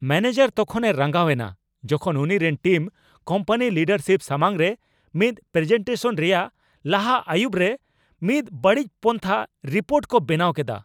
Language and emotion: Santali, angry